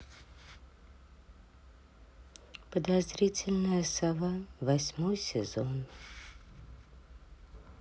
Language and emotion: Russian, sad